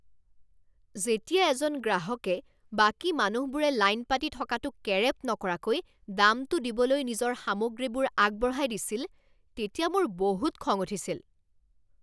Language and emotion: Assamese, angry